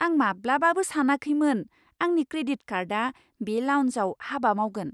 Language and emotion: Bodo, surprised